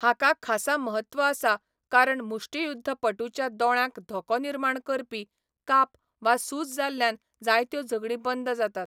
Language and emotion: Goan Konkani, neutral